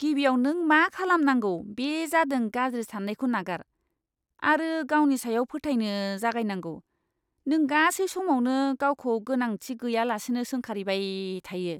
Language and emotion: Bodo, disgusted